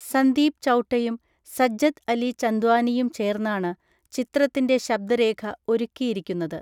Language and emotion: Malayalam, neutral